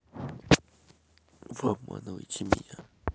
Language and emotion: Russian, neutral